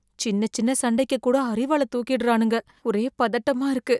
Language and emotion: Tamil, fearful